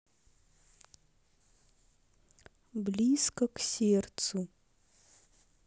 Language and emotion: Russian, neutral